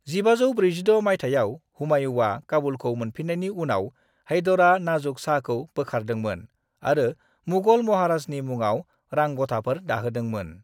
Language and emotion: Bodo, neutral